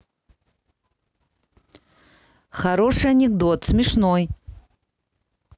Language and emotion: Russian, neutral